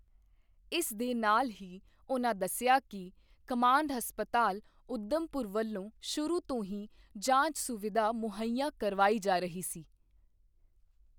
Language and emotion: Punjabi, neutral